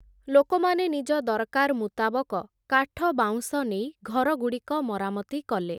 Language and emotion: Odia, neutral